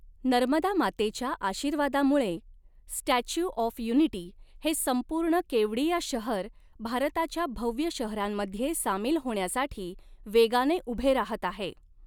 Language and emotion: Marathi, neutral